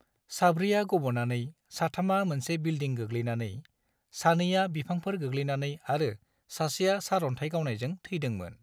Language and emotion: Bodo, neutral